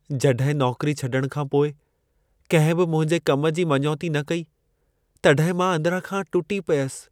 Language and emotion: Sindhi, sad